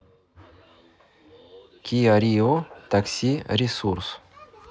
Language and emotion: Russian, neutral